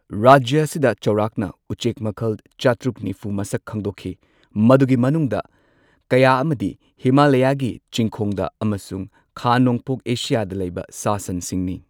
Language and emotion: Manipuri, neutral